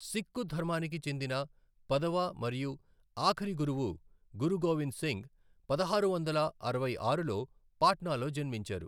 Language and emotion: Telugu, neutral